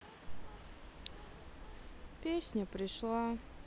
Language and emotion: Russian, sad